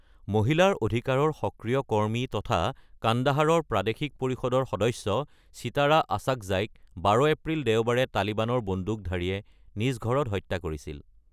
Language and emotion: Assamese, neutral